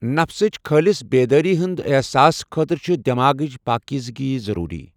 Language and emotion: Kashmiri, neutral